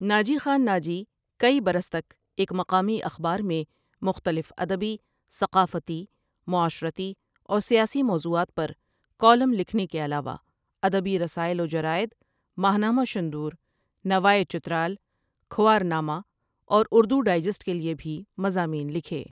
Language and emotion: Urdu, neutral